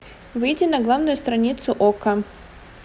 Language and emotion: Russian, neutral